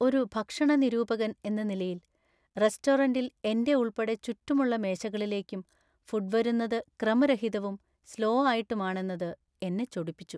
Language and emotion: Malayalam, sad